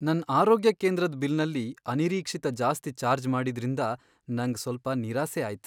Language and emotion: Kannada, sad